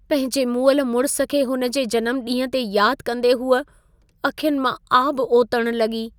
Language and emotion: Sindhi, sad